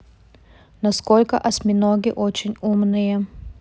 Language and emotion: Russian, neutral